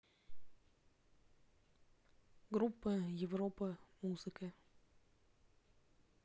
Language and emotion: Russian, neutral